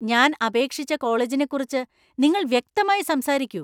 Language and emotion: Malayalam, angry